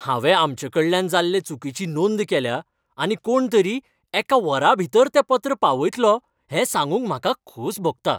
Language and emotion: Goan Konkani, happy